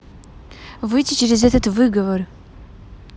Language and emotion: Russian, angry